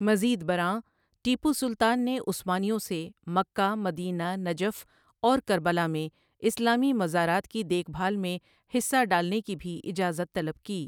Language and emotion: Urdu, neutral